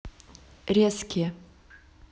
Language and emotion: Russian, neutral